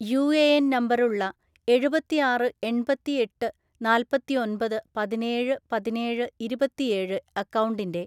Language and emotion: Malayalam, neutral